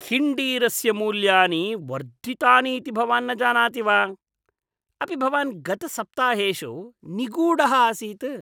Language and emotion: Sanskrit, disgusted